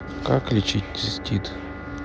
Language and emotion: Russian, neutral